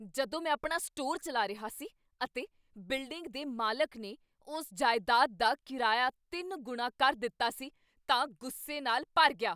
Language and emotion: Punjabi, angry